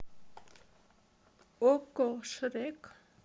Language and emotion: Russian, neutral